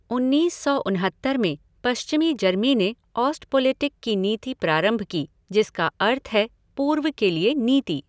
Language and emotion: Hindi, neutral